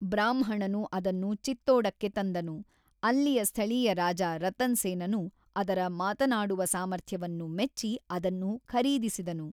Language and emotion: Kannada, neutral